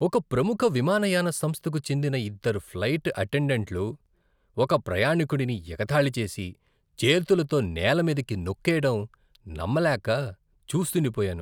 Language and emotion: Telugu, disgusted